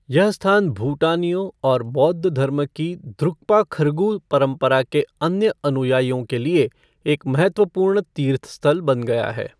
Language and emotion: Hindi, neutral